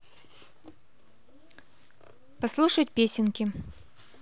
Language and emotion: Russian, neutral